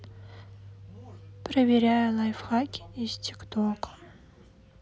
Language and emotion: Russian, sad